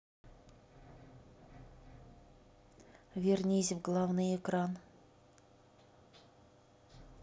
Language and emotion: Russian, neutral